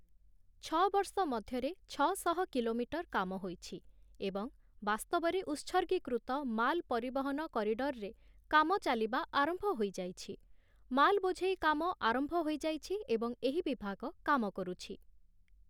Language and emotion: Odia, neutral